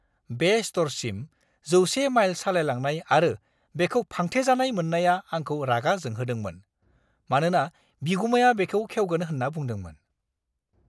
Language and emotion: Bodo, angry